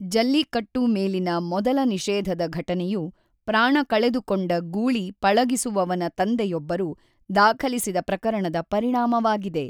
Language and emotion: Kannada, neutral